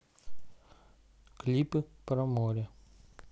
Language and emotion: Russian, neutral